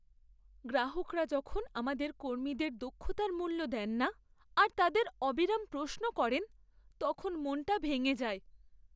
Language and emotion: Bengali, sad